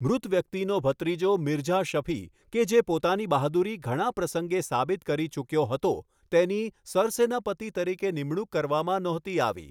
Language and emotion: Gujarati, neutral